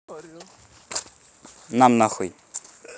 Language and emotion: Russian, angry